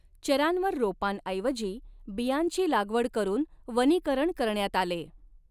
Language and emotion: Marathi, neutral